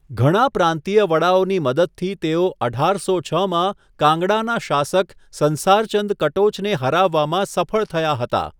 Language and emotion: Gujarati, neutral